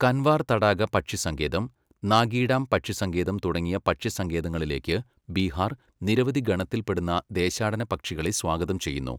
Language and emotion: Malayalam, neutral